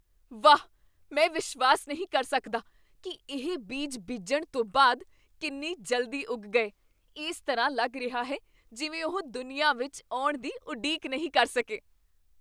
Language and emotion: Punjabi, surprised